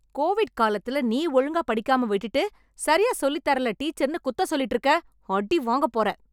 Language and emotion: Tamil, angry